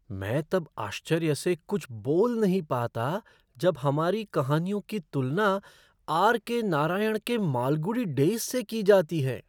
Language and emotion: Hindi, surprised